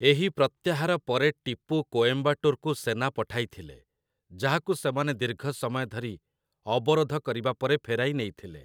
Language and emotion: Odia, neutral